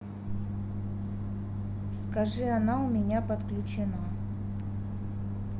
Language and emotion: Russian, neutral